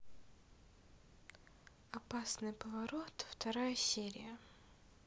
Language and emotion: Russian, neutral